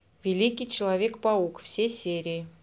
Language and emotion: Russian, neutral